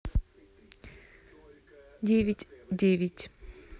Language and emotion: Russian, neutral